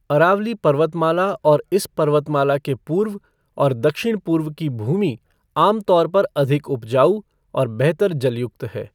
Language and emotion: Hindi, neutral